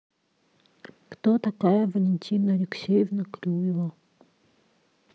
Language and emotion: Russian, neutral